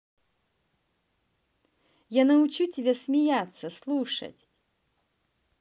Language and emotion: Russian, positive